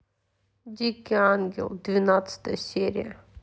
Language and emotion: Russian, neutral